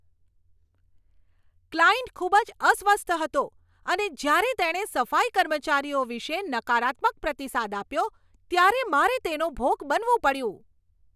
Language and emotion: Gujarati, angry